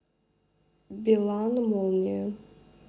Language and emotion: Russian, neutral